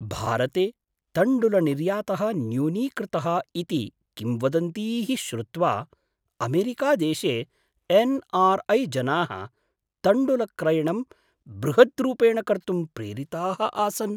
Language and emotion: Sanskrit, surprised